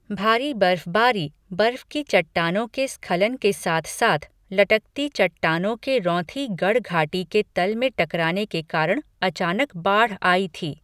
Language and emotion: Hindi, neutral